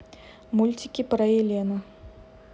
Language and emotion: Russian, neutral